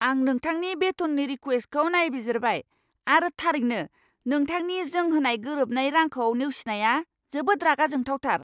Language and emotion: Bodo, angry